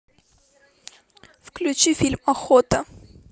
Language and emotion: Russian, neutral